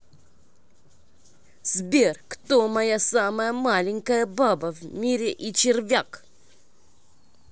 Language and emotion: Russian, angry